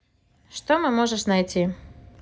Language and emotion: Russian, neutral